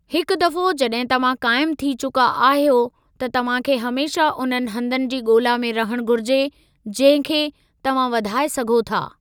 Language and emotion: Sindhi, neutral